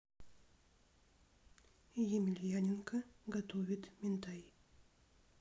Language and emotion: Russian, neutral